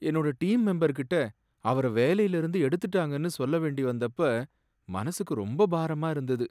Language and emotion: Tamil, sad